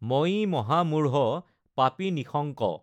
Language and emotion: Assamese, neutral